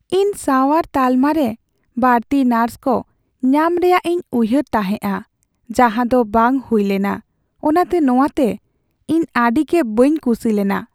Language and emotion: Santali, sad